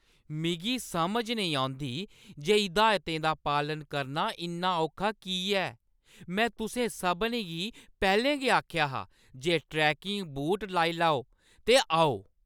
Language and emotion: Dogri, angry